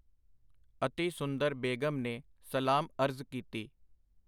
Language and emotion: Punjabi, neutral